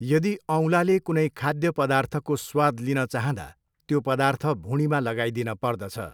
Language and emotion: Nepali, neutral